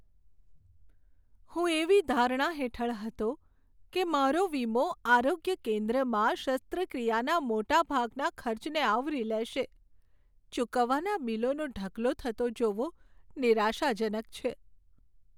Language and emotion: Gujarati, sad